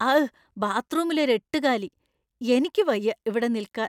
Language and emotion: Malayalam, disgusted